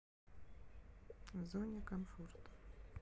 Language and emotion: Russian, neutral